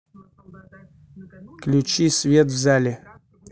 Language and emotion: Russian, neutral